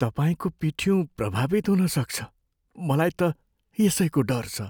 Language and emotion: Nepali, fearful